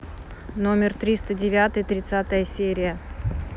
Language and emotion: Russian, neutral